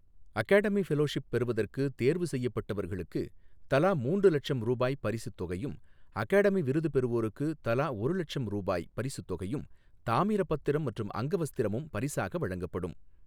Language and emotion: Tamil, neutral